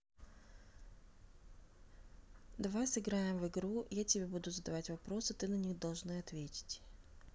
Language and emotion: Russian, neutral